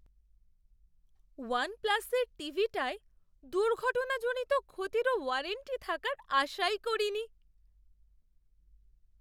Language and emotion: Bengali, surprised